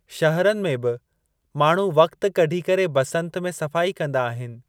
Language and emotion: Sindhi, neutral